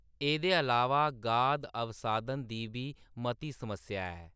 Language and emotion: Dogri, neutral